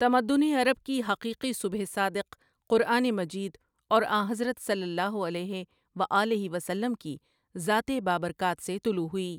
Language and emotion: Urdu, neutral